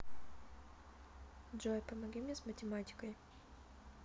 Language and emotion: Russian, neutral